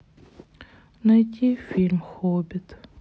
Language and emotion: Russian, sad